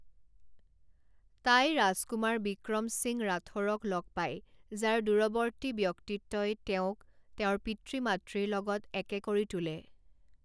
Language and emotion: Assamese, neutral